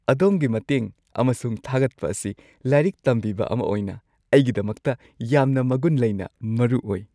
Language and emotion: Manipuri, happy